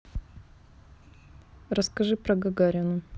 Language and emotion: Russian, neutral